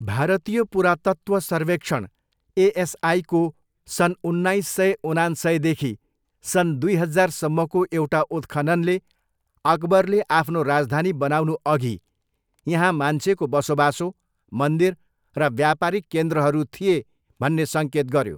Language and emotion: Nepali, neutral